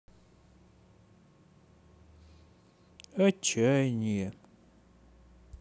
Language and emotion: Russian, sad